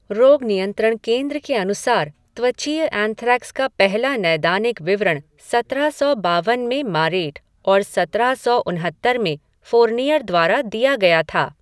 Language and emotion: Hindi, neutral